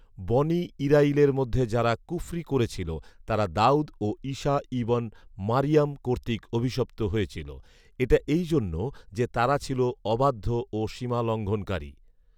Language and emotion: Bengali, neutral